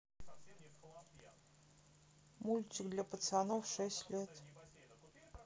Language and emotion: Russian, neutral